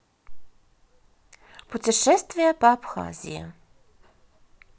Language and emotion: Russian, positive